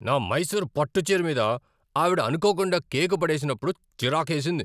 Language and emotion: Telugu, angry